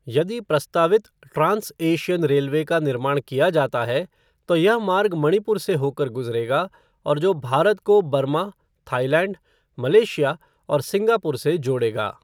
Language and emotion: Hindi, neutral